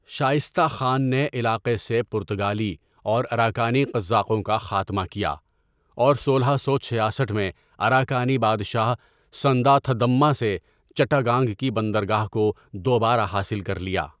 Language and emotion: Urdu, neutral